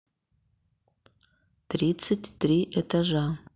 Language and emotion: Russian, neutral